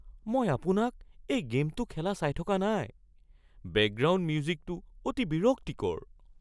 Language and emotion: Assamese, fearful